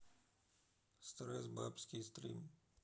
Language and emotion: Russian, neutral